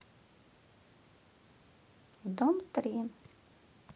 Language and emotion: Russian, neutral